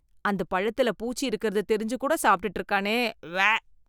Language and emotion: Tamil, disgusted